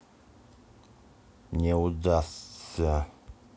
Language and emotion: Russian, angry